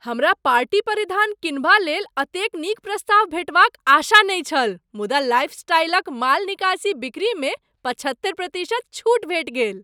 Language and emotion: Maithili, surprised